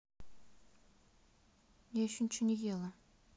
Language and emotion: Russian, sad